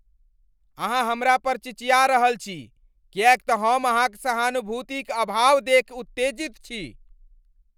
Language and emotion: Maithili, angry